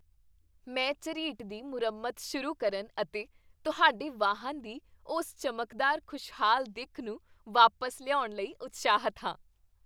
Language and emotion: Punjabi, happy